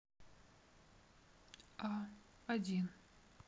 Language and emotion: Russian, neutral